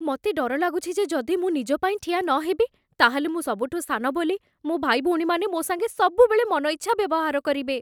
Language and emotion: Odia, fearful